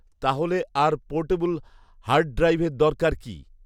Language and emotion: Bengali, neutral